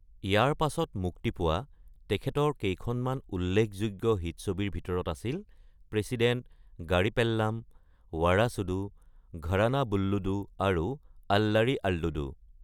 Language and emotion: Assamese, neutral